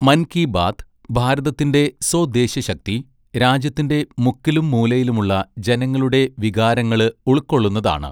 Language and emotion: Malayalam, neutral